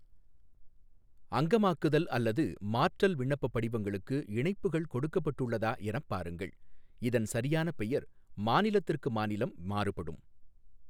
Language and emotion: Tamil, neutral